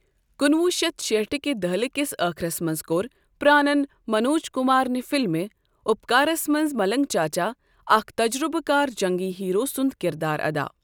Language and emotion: Kashmiri, neutral